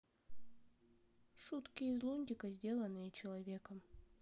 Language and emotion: Russian, neutral